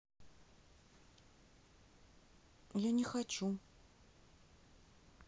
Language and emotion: Russian, sad